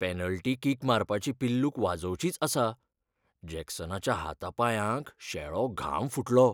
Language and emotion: Goan Konkani, fearful